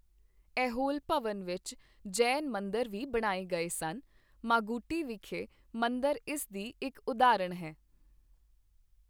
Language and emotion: Punjabi, neutral